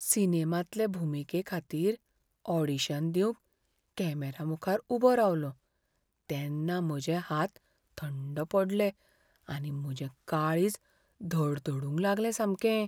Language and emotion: Goan Konkani, fearful